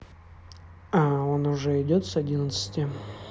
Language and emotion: Russian, neutral